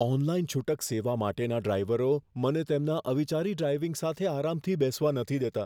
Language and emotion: Gujarati, fearful